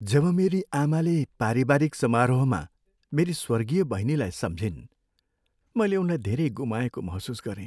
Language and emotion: Nepali, sad